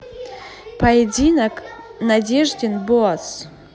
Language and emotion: Russian, neutral